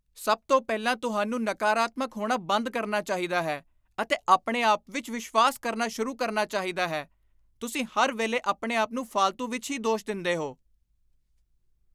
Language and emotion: Punjabi, disgusted